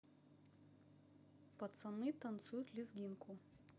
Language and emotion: Russian, neutral